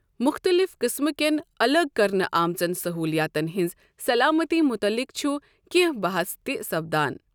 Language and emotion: Kashmiri, neutral